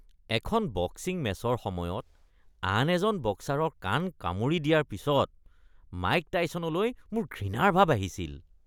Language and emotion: Assamese, disgusted